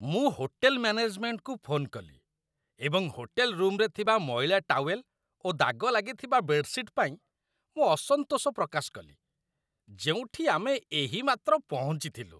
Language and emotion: Odia, disgusted